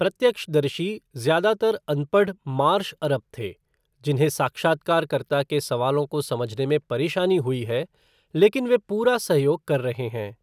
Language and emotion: Hindi, neutral